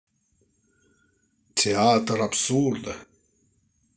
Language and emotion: Russian, positive